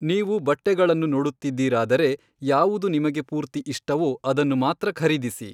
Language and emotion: Kannada, neutral